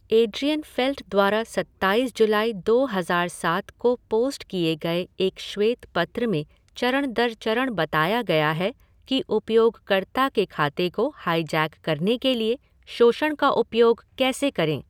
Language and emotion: Hindi, neutral